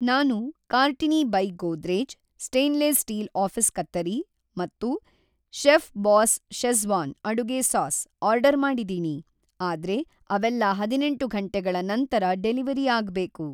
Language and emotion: Kannada, neutral